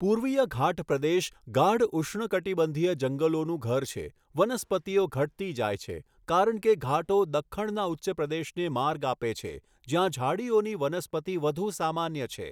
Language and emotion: Gujarati, neutral